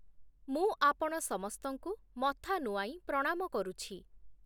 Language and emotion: Odia, neutral